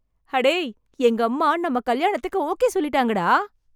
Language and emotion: Tamil, happy